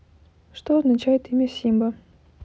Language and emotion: Russian, neutral